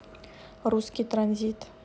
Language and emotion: Russian, neutral